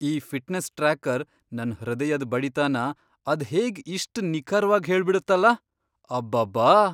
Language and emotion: Kannada, surprised